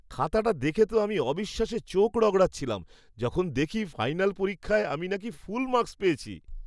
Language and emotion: Bengali, surprised